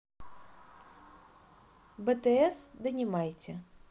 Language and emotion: Russian, neutral